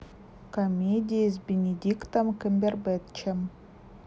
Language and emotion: Russian, neutral